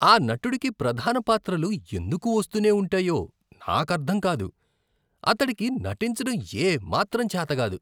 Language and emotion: Telugu, disgusted